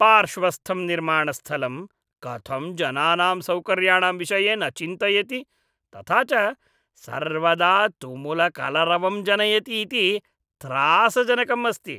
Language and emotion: Sanskrit, disgusted